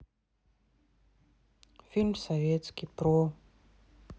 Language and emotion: Russian, neutral